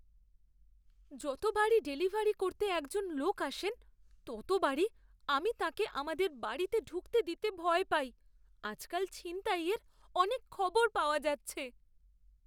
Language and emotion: Bengali, fearful